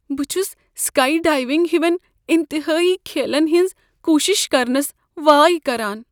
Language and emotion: Kashmiri, fearful